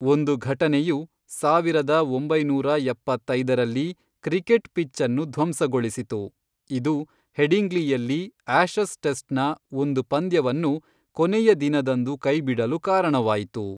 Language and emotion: Kannada, neutral